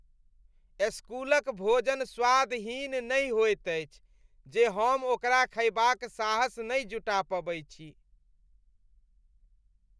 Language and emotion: Maithili, disgusted